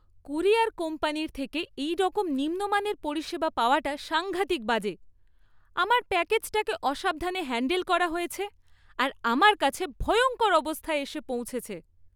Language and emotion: Bengali, disgusted